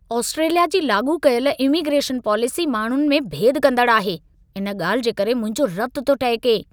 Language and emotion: Sindhi, angry